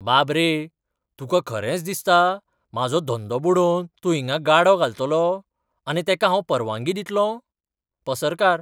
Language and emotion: Goan Konkani, surprised